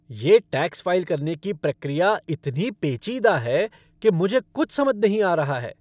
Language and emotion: Hindi, angry